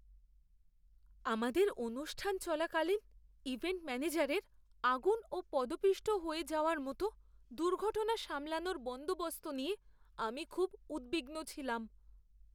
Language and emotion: Bengali, fearful